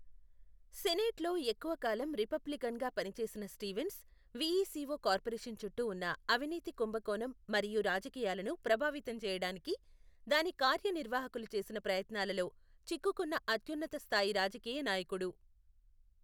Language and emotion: Telugu, neutral